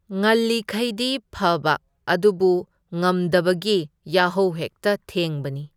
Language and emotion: Manipuri, neutral